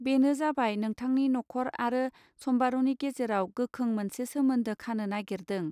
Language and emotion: Bodo, neutral